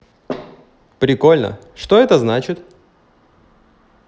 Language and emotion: Russian, positive